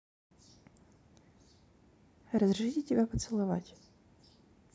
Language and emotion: Russian, neutral